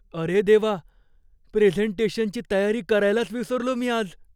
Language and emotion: Marathi, fearful